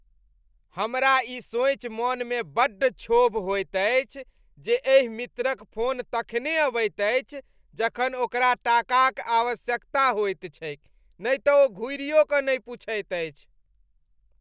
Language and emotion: Maithili, disgusted